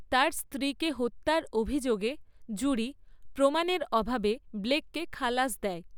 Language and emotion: Bengali, neutral